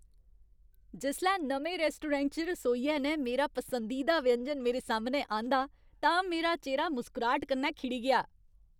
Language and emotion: Dogri, happy